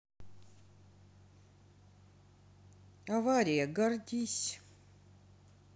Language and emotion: Russian, sad